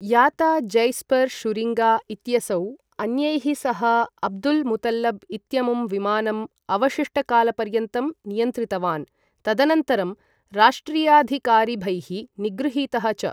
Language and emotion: Sanskrit, neutral